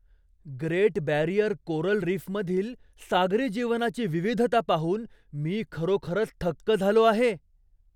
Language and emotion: Marathi, surprised